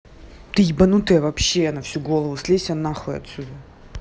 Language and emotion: Russian, angry